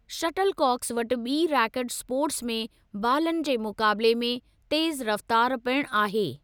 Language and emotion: Sindhi, neutral